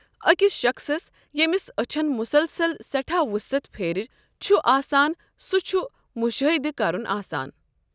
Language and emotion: Kashmiri, neutral